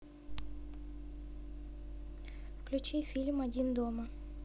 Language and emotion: Russian, neutral